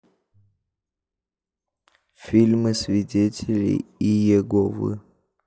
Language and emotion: Russian, neutral